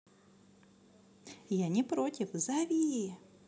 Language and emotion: Russian, positive